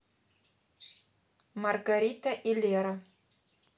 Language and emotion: Russian, neutral